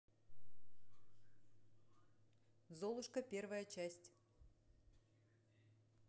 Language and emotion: Russian, neutral